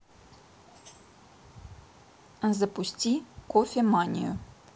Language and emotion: Russian, neutral